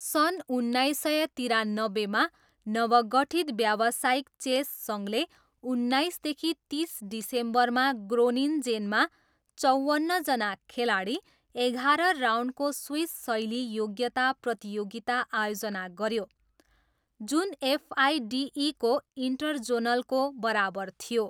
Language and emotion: Nepali, neutral